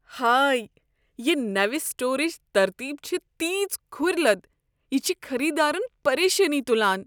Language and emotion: Kashmiri, disgusted